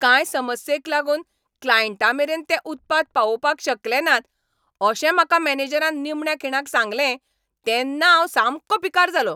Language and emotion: Goan Konkani, angry